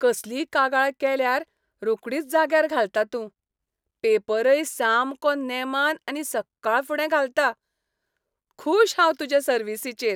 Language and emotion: Goan Konkani, happy